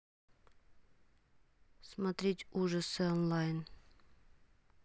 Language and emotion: Russian, neutral